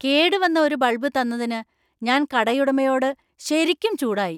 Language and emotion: Malayalam, angry